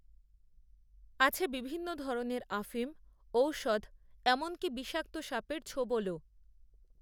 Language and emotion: Bengali, neutral